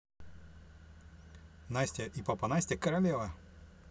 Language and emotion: Russian, neutral